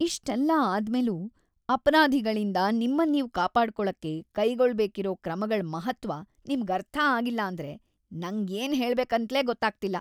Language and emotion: Kannada, disgusted